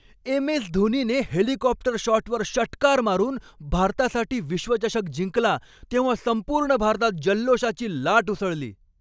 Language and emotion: Marathi, happy